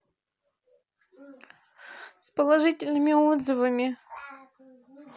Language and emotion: Russian, sad